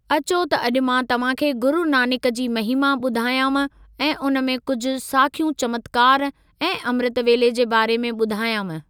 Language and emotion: Sindhi, neutral